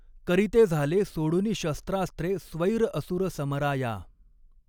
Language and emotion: Marathi, neutral